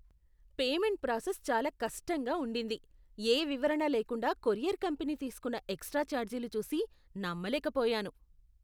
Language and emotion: Telugu, disgusted